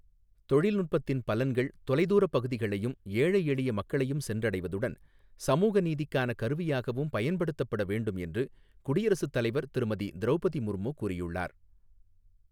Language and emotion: Tamil, neutral